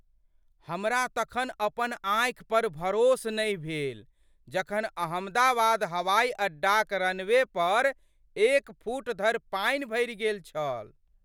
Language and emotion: Maithili, surprised